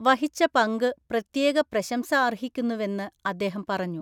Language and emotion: Malayalam, neutral